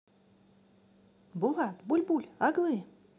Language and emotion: Russian, positive